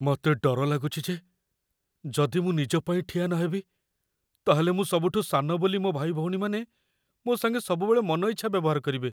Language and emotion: Odia, fearful